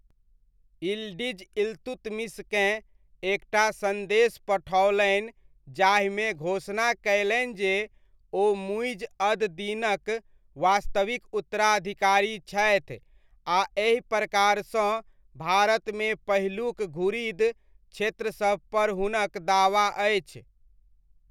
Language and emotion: Maithili, neutral